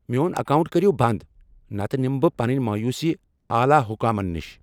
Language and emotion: Kashmiri, angry